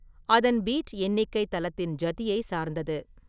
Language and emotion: Tamil, neutral